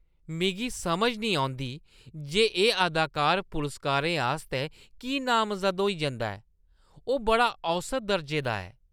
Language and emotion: Dogri, disgusted